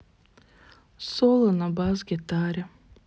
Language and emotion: Russian, sad